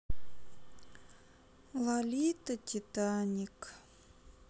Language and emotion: Russian, sad